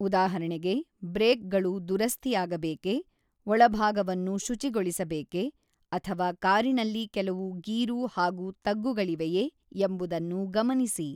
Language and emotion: Kannada, neutral